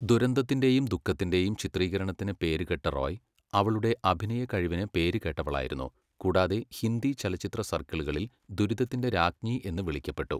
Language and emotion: Malayalam, neutral